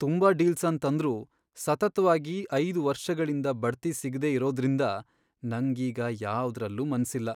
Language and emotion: Kannada, sad